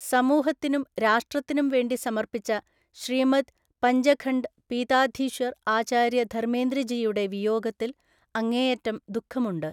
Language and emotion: Malayalam, neutral